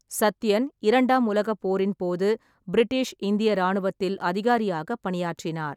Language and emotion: Tamil, neutral